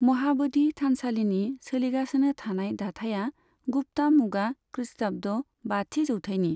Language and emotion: Bodo, neutral